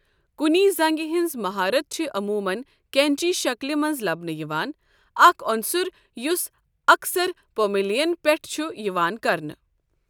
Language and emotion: Kashmiri, neutral